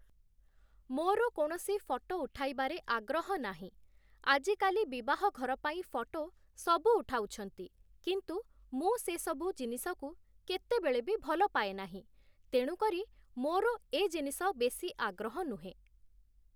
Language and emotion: Odia, neutral